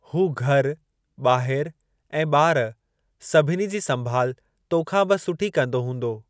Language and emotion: Sindhi, neutral